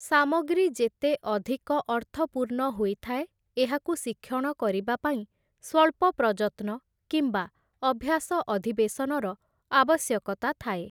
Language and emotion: Odia, neutral